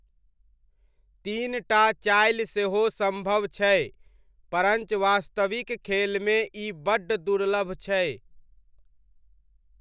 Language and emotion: Maithili, neutral